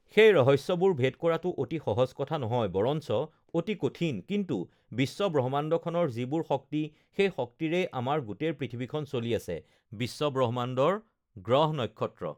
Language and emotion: Assamese, neutral